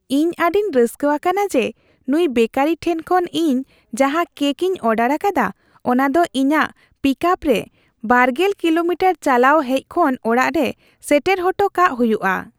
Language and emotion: Santali, happy